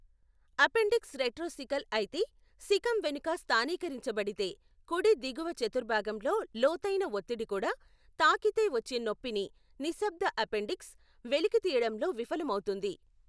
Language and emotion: Telugu, neutral